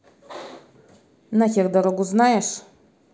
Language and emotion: Russian, angry